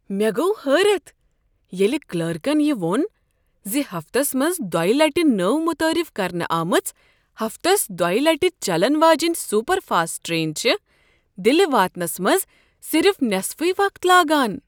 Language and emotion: Kashmiri, surprised